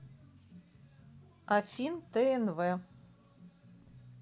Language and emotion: Russian, neutral